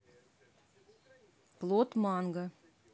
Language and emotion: Russian, neutral